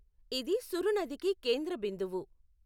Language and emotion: Telugu, neutral